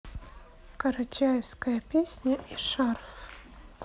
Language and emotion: Russian, neutral